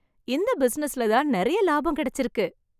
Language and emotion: Tamil, happy